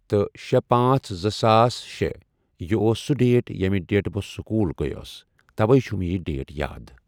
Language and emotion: Kashmiri, neutral